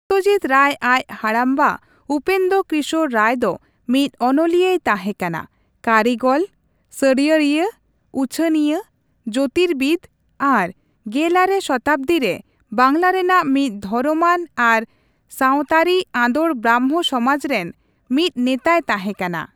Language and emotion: Santali, neutral